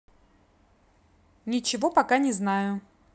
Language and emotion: Russian, neutral